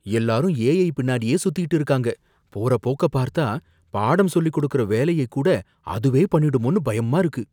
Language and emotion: Tamil, fearful